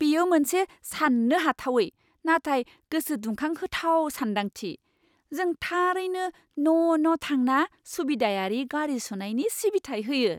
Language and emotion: Bodo, surprised